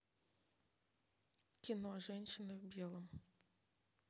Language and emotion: Russian, neutral